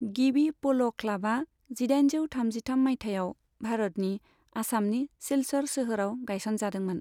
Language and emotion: Bodo, neutral